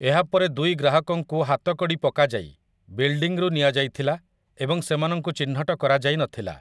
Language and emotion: Odia, neutral